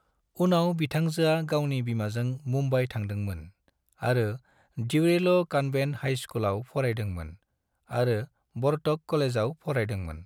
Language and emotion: Bodo, neutral